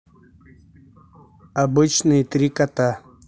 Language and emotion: Russian, neutral